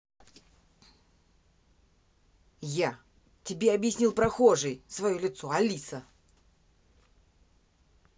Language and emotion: Russian, angry